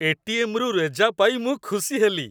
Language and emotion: Odia, happy